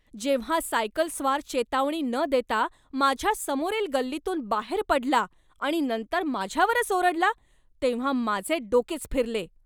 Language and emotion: Marathi, angry